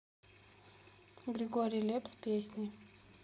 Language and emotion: Russian, neutral